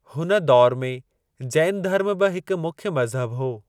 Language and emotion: Sindhi, neutral